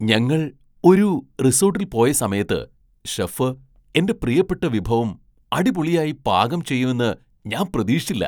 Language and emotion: Malayalam, surprised